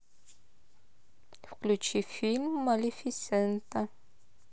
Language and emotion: Russian, neutral